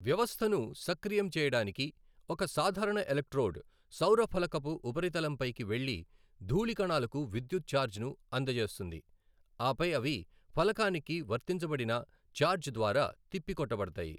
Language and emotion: Telugu, neutral